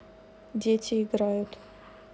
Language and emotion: Russian, neutral